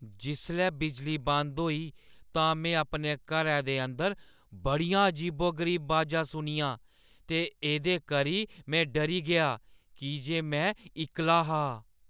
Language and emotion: Dogri, fearful